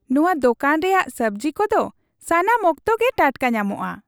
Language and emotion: Santali, happy